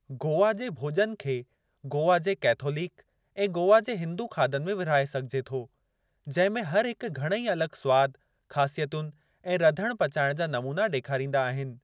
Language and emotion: Sindhi, neutral